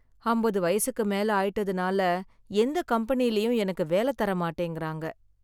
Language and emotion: Tamil, sad